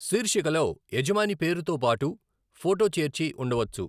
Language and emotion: Telugu, neutral